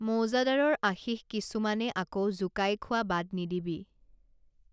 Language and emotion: Assamese, neutral